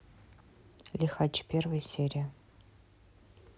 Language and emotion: Russian, neutral